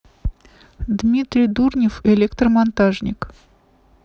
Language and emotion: Russian, neutral